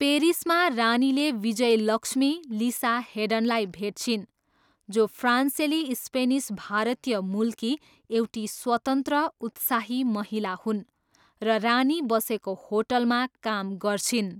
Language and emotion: Nepali, neutral